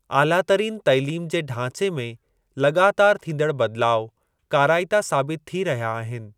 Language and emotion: Sindhi, neutral